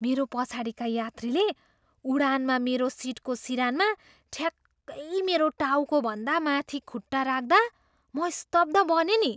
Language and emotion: Nepali, surprised